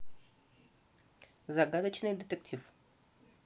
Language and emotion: Russian, neutral